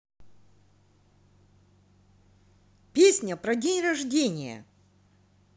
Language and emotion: Russian, positive